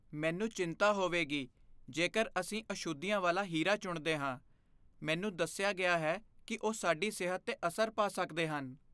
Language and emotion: Punjabi, fearful